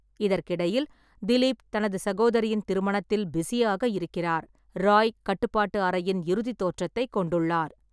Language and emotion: Tamil, neutral